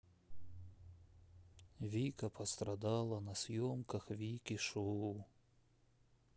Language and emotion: Russian, sad